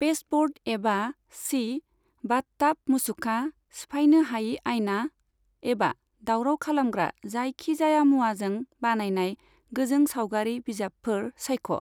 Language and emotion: Bodo, neutral